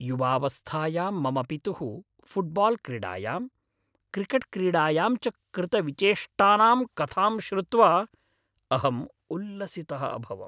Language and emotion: Sanskrit, happy